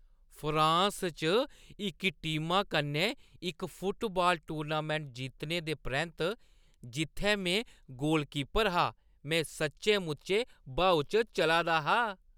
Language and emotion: Dogri, happy